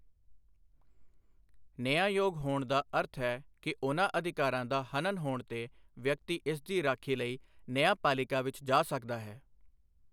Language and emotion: Punjabi, neutral